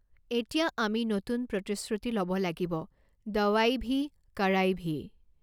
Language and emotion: Assamese, neutral